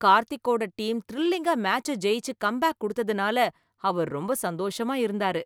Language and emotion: Tamil, happy